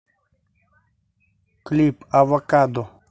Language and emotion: Russian, neutral